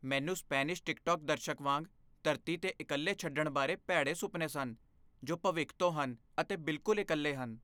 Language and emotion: Punjabi, fearful